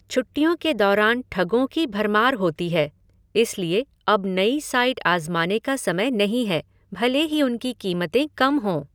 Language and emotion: Hindi, neutral